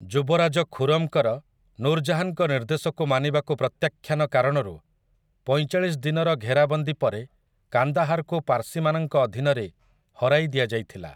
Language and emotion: Odia, neutral